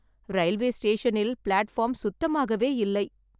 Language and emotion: Tamil, sad